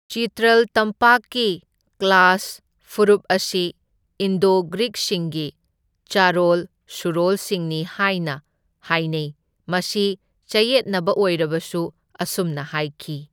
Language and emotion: Manipuri, neutral